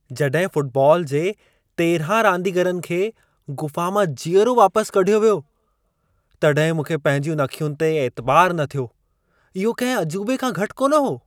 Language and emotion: Sindhi, surprised